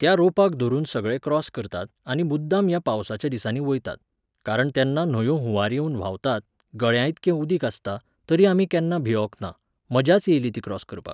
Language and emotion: Goan Konkani, neutral